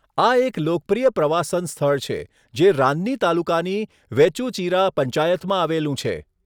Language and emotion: Gujarati, neutral